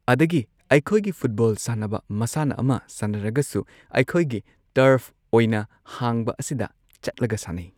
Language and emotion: Manipuri, neutral